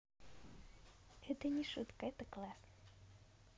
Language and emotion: Russian, positive